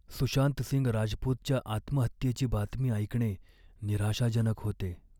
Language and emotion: Marathi, sad